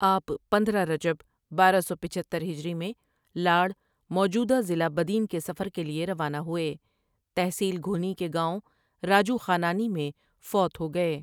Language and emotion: Urdu, neutral